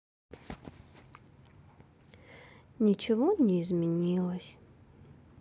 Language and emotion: Russian, sad